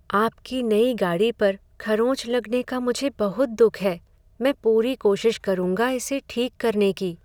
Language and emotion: Hindi, sad